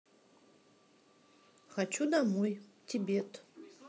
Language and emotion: Russian, neutral